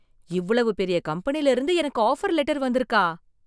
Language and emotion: Tamil, surprised